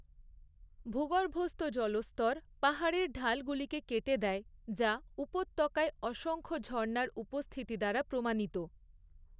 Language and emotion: Bengali, neutral